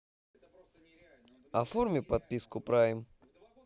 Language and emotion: Russian, neutral